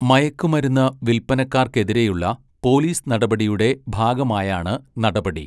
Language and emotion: Malayalam, neutral